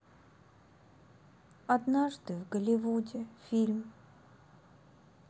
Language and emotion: Russian, sad